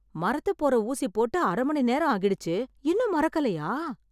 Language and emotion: Tamil, surprised